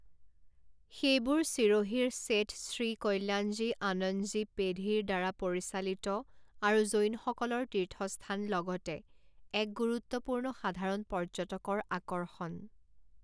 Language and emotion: Assamese, neutral